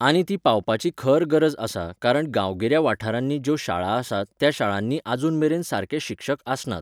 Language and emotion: Goan Konkani, neutral